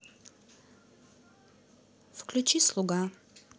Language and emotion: Russian, neutral